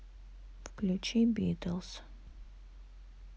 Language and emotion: Russian, neutral